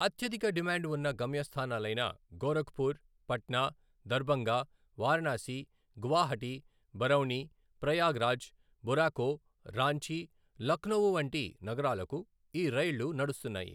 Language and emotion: Telugu, neutral